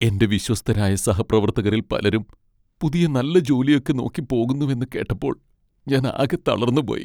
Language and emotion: Malayalam, sad